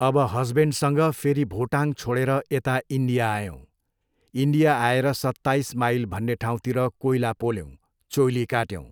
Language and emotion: Nepali, neutral